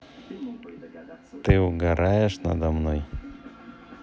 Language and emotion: Russian, neutral